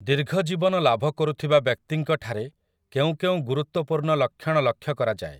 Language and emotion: Odia, neutral